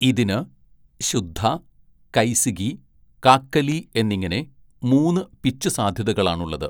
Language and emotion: Malayalam, neutral